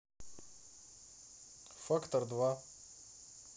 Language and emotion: Russian, neutral